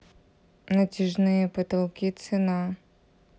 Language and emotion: Russian, neutral